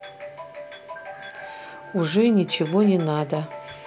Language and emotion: Russian, neutral